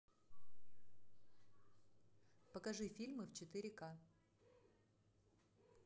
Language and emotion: Russian, neutral